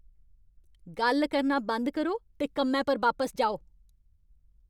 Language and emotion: Dogri, angry